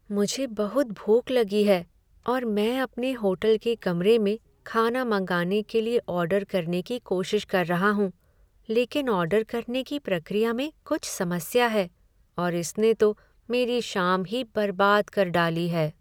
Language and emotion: Hindi, sad